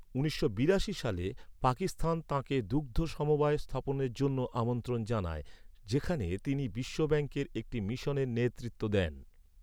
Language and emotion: Bengali, neutral